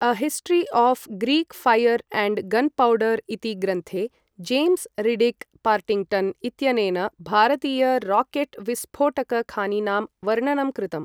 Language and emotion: Sanskrit, neutral